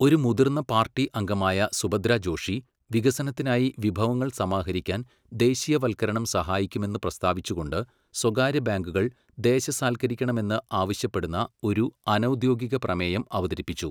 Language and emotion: Malayalam, neutral